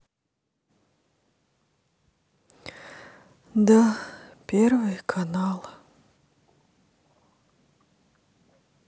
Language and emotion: Russian, sad